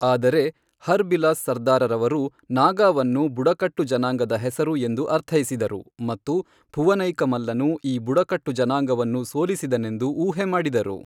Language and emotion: Kannada, neutral